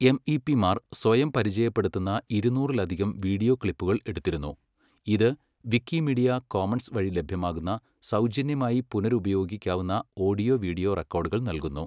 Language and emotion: Malayalam, neutral